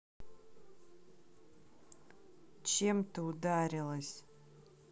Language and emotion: Russian, neutral